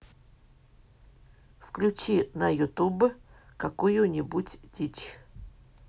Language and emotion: Russian, neutral